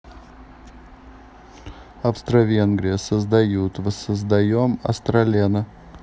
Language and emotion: Russian, neutral